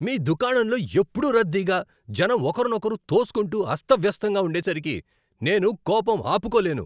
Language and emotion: Telugu, angry